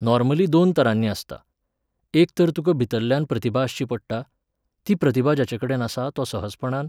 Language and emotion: Goan Konkani, neutral